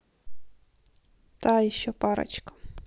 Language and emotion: Russian, neutral